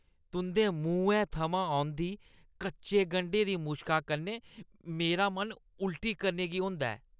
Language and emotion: Dogri, disgusted